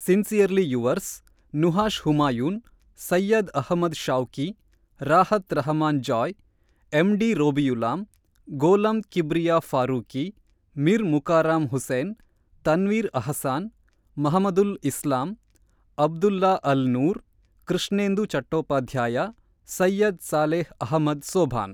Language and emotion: Kannada, neutral